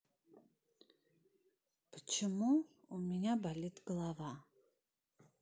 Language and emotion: Russian, sad